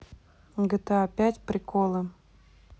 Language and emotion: Russian, neutral